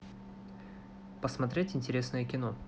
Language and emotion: Russian, neutral